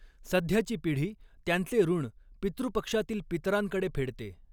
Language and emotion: Marathi, neutral